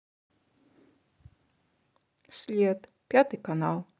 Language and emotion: Russian, neutral